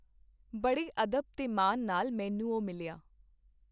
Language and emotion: Punjabi, neutral